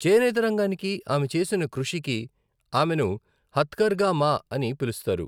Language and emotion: Telugu, neutral